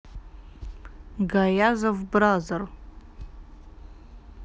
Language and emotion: Russian, neutral